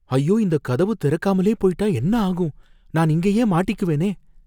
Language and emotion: Tamil, fearful